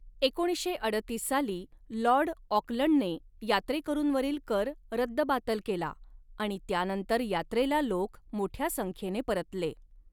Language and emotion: Marathi, neutral